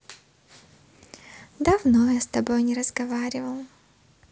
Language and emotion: Russian, positive